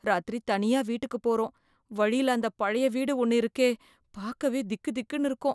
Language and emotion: Tamil, fearful